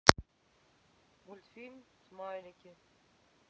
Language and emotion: Russian, neutral